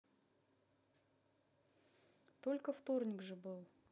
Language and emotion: Russian, neutral